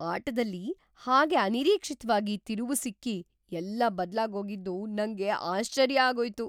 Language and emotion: Kannada, surprised